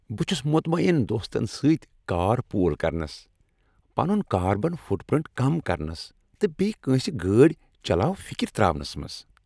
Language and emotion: Kashmiri, happy